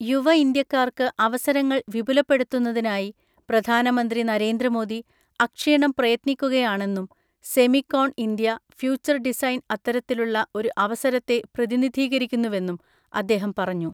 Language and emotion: Malayalam, neutral